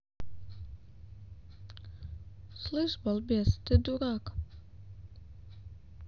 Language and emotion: Russian, neutral